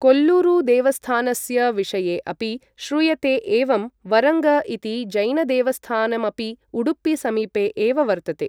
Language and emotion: Sanskrit, neutral